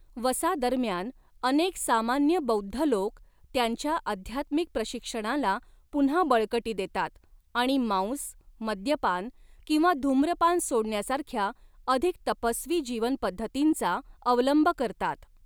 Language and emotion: Marathi, neutral